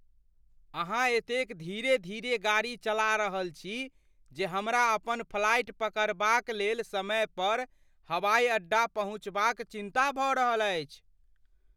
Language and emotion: Maithili, fearful